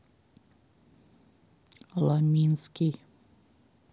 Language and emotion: Russian, neutral